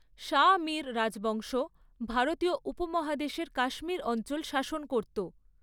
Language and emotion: Bengali, neutral